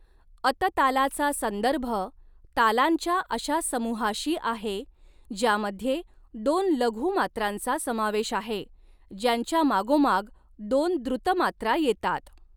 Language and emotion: Marathi, neutral